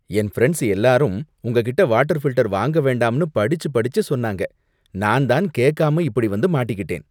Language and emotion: Tamil, disgusted